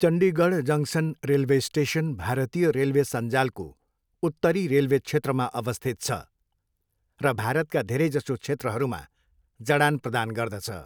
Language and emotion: Nepali, neutral